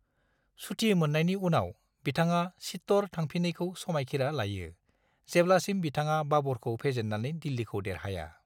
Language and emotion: Bodo, neutral